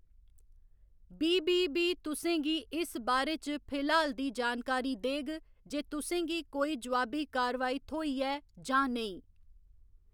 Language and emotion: Dogri, neutral